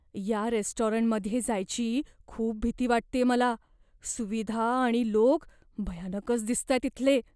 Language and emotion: Marathi, fearful